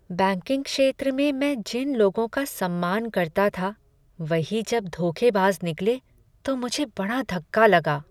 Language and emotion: Hindi, sad